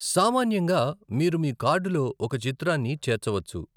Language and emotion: Telugu, neutral